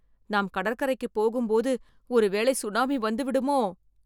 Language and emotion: Tamil, fearful